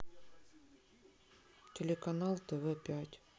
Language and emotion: Russian, sad